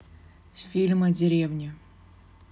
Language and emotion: Russian, neutral